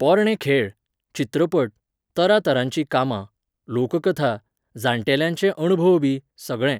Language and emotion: Goan Konkani, neutral